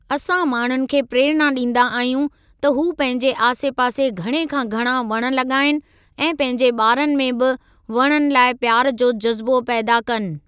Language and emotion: Sindhi, neutral